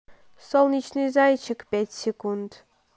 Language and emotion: Russian, neutral